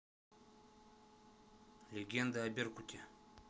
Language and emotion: Russian, neutral